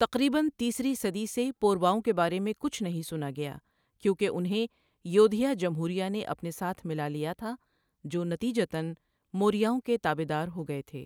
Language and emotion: Urdu, neutral